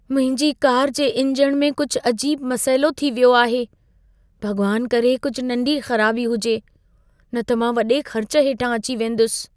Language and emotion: Sindhi, fearful